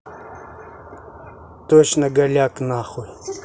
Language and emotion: Russian, angry